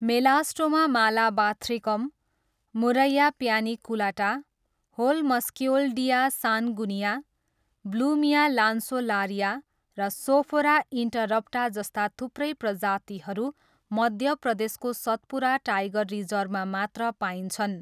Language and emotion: Nepali, neutral